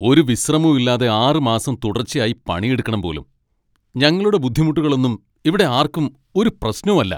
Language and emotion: Malayalam, angry